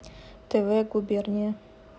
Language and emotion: Russian, neutral